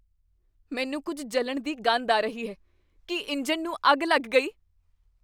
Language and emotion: Punjabi, fearful